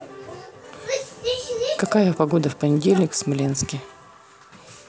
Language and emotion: Russian, neutral